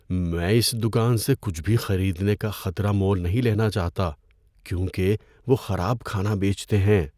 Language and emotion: Urdu, fearful